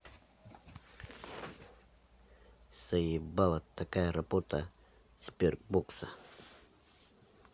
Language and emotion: Russian, angry